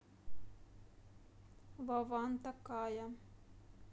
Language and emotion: Russian, neutral